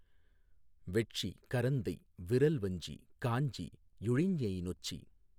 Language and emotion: Tamil, neutral